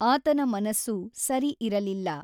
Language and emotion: Kannada, neutral